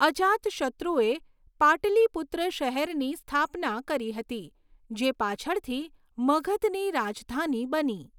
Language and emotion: Gujarati, neutral